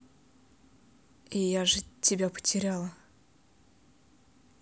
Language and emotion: Russian, neutral